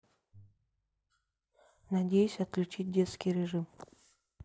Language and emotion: Russian, neutral